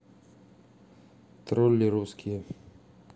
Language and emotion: Russian, neutral